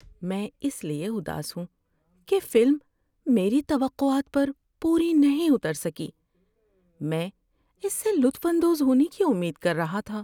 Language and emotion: Urdu, sad